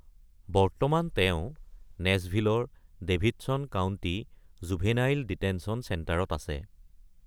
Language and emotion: Assamese, neutral